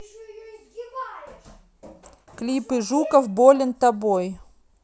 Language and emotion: Russian, neutral